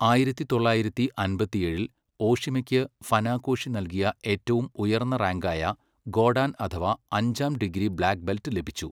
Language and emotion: Malayalam, neutral